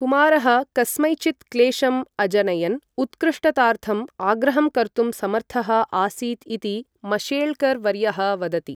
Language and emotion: Sanskrit, neutral